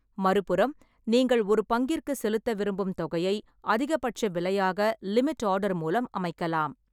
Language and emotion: Tamil, neutral